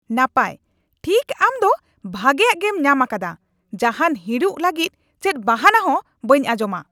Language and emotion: Santali, angry